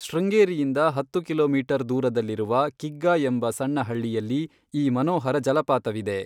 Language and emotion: Kannada, neutral